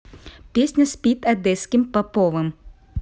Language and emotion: Russian, neutral